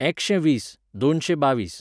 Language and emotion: Goan Konkani, neutral